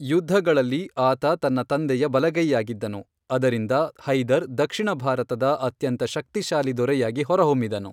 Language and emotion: Kannada, neutral